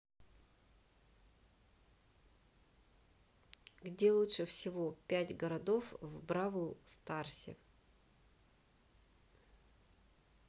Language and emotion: Russian, neutral